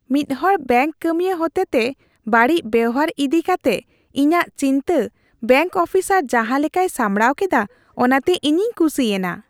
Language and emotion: Santali, happy